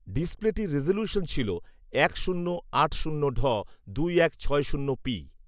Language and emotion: Bengali, neutral